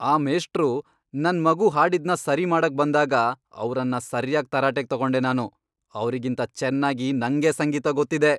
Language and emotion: Kannada, angry